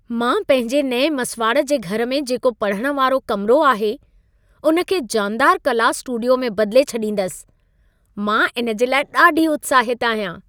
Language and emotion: Sindhi, happy